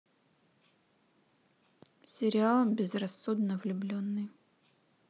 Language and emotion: Russian, neutral